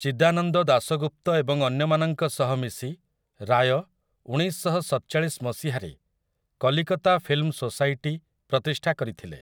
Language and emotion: Odia, neutral